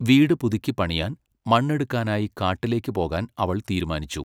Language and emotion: Malayalam, neutral